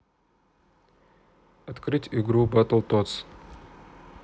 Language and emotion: Russian, neutral